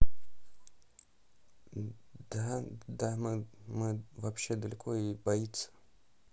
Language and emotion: Russian, neutral